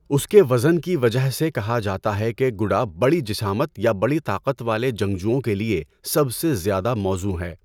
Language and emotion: Urdu, neutral